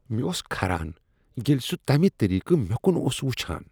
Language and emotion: Kashmiri, disgusted